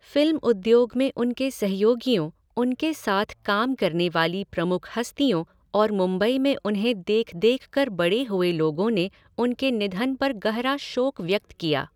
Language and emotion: Hindi, neutral